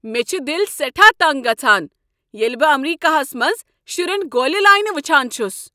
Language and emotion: Kashmiri, angry